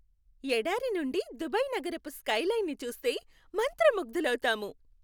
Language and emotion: Telugu, happy